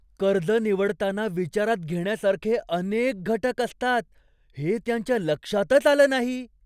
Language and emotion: Marathi, surprised